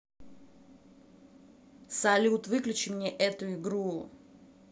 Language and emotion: Russian, angry